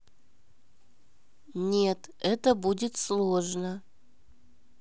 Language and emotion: Russian, neutral